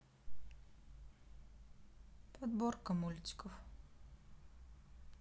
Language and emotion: Russian, neutral